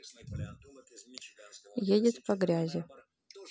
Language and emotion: Russian, neutral